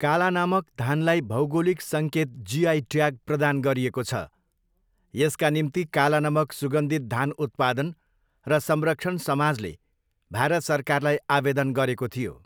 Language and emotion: Nepali, neutral